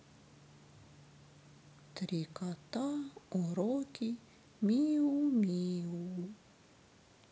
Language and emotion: Russian, sad